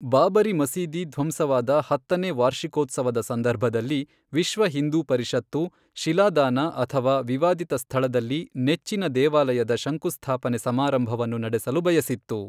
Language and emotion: Kannada, neutral